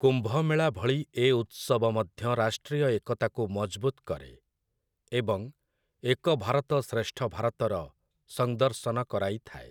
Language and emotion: Odia, neutral